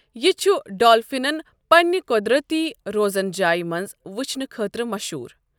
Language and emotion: Kashmiri, neutral